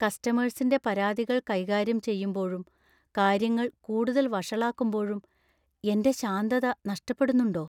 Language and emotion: Malayalam, fearful